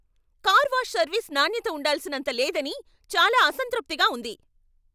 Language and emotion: Telugu, angry